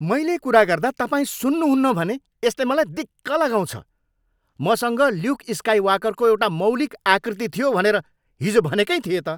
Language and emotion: Nepali, angry